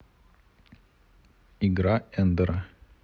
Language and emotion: Russian, neutral